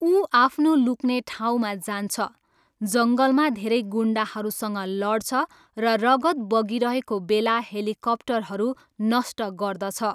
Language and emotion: Nepali, neutral